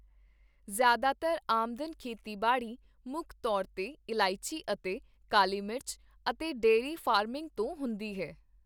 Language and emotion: Punjabi, neutral